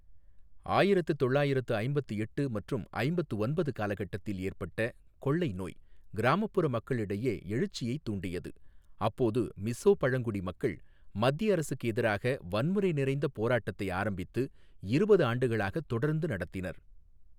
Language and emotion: Tamil, neutral